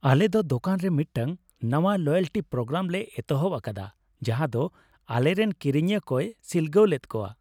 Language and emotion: Santali, happy